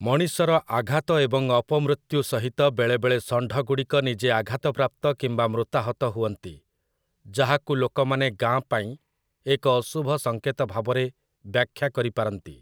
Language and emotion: Odia, neutral